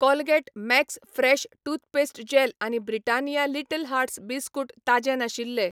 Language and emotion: Goan Konkani, neutral